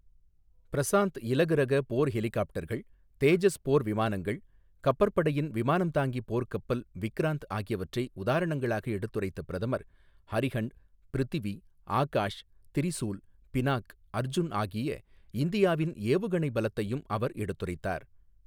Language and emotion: Tamil, neutral